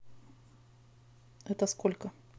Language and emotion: Russian, neutral